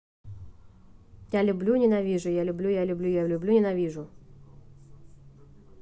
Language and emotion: Russian, neutral